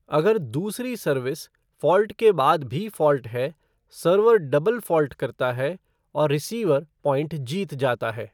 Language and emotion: Hindi, neutral